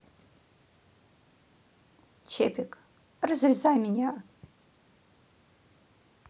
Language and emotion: Russian, neutral